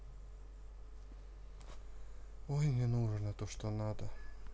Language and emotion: Russian, neutral